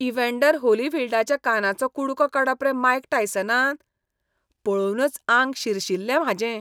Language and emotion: Goan Konkani, disgusted